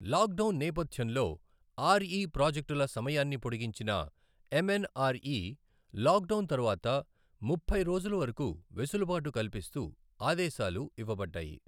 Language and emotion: Telugu, neutral